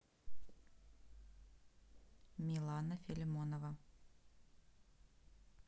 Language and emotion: Russian, neutral